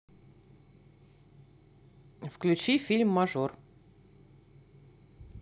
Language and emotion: Russian, neutral